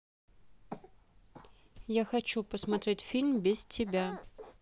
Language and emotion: Russian, neutral